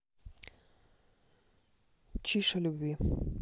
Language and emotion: Russian, neutral